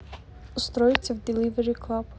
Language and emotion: Russian, neutral